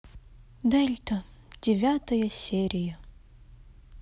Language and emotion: Russian, sad